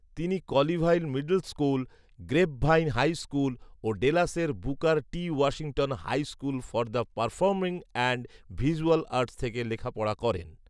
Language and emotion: Bengali, neutral